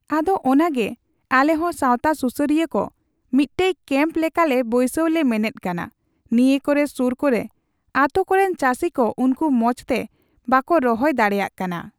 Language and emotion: Santali, neutral